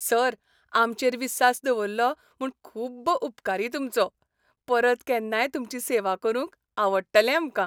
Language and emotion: Goan Konkani, happy